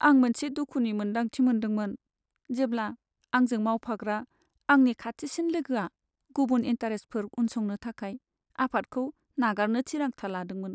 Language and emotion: Bodo, sad